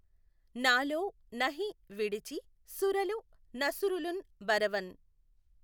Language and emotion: Telugu, neutral